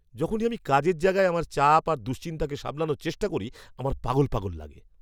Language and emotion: Bengali, angry